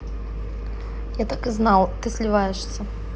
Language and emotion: Russian, neutral